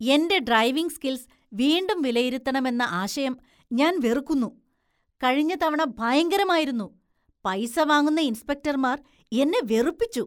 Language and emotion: Malayalam, disgusted